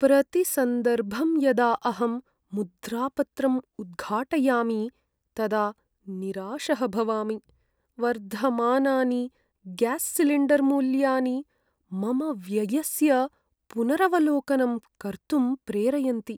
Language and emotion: Sanskrit, sad